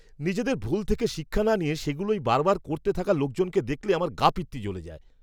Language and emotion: Bengali, angry